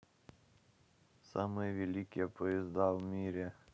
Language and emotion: Russian, neutral